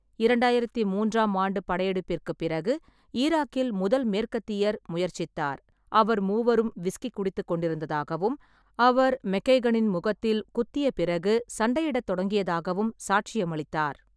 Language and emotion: Tamil, neutral